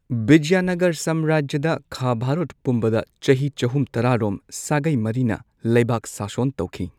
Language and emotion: Manipuri, neutral